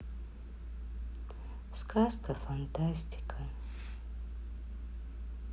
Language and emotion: Russian, sad